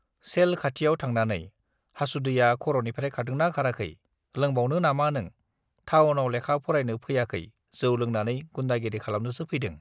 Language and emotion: Bodo, neutral